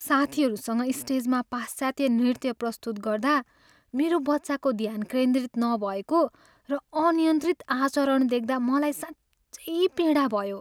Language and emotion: Nepali, sad